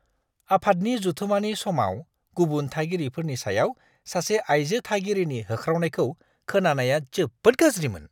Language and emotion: Bodo, disgusted